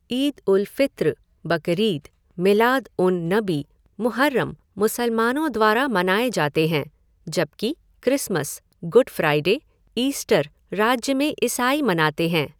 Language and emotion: Hindi, neutral